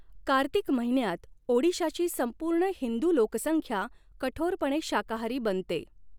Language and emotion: Marathi, neutral